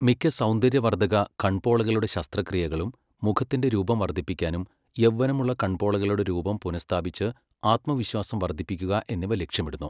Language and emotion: Malayalam, neutral